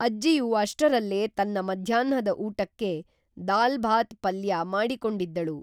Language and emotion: Kannada, neutral